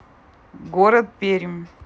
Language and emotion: Russian, neutral